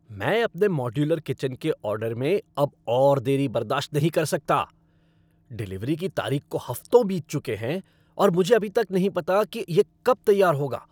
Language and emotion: Hindi, angry